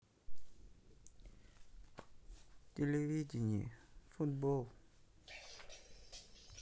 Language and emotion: Russian, sad